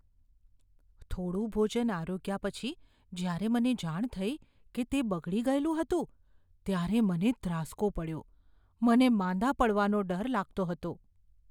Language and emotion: Gujarati, fearful